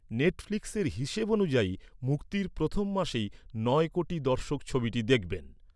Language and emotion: Bengali, neutral